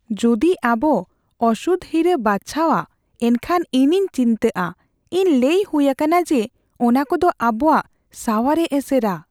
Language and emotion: Santali, fearful